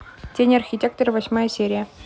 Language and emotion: Russian, neutral